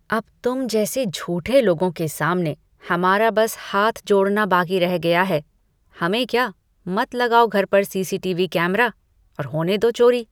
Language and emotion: Hindi, disgusted